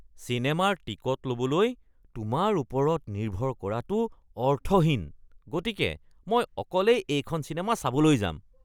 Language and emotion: Assamese, disgusted